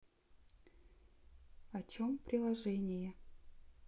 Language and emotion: Russian, neutral